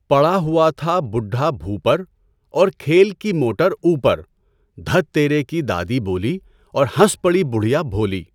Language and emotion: Urdu, neutral